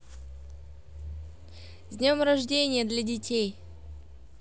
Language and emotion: Russian, positive